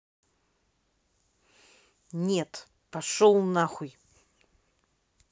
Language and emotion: Russian, angry